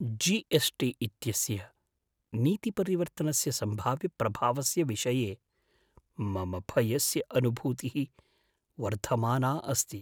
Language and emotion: Sanskrit, fearful